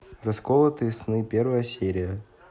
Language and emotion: Russian, neutral